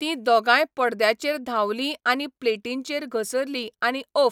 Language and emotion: Goan Konkani, neutral